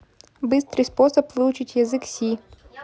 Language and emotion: Russian, neutral